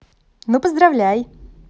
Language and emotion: Russian, positive